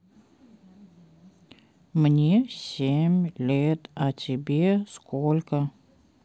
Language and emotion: Russian, neutral